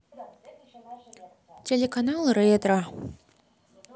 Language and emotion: Russian, neutral